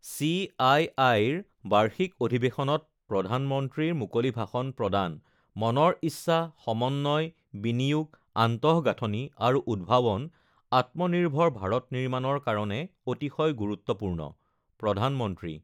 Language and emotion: Assamese, neutral